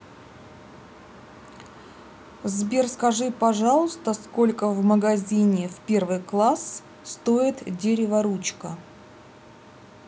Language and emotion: Russian, neutral